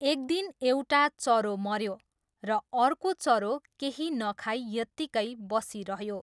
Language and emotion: Nepali, neutral